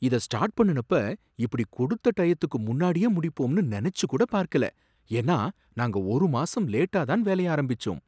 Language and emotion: Tamil, surprised